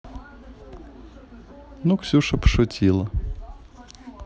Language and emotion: Russian, neutral